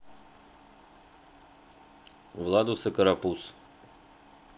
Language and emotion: Russian, neutral